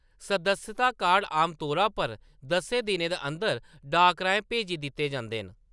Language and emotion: Dogri, neutral